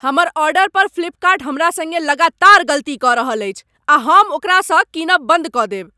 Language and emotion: Maithili, angry